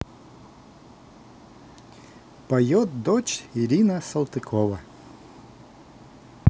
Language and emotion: Russian, positive